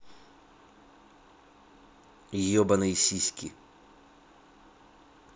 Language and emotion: Russian, angry